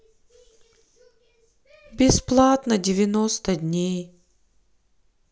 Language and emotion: Russian, sad